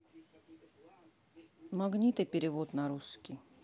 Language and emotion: Russian, neutral